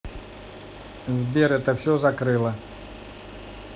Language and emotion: Russian, neutral